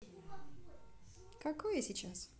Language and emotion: Russian, positive